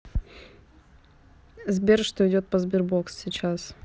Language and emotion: Russian, neutral